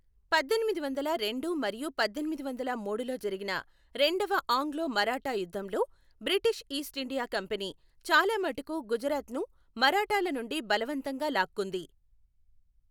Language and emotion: Telugu, neutral